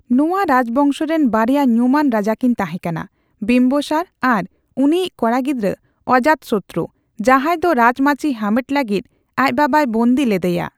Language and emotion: Santali, neutral